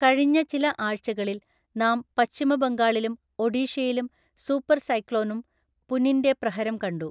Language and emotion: Malayalam, neutral